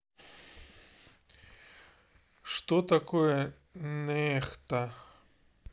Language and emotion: Russian, neutral